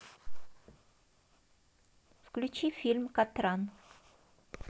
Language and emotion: Russian, neutral